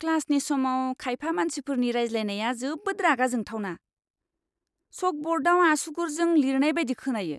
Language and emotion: Bodo, disgusted